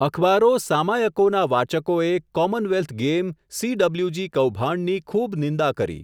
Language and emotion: Gujarati, neutral